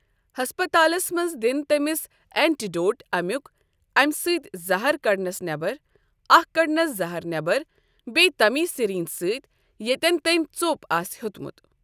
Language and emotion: Kashmiri, neutral